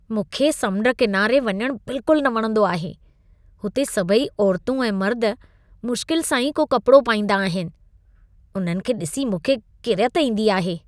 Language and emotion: Sindhi, disgusted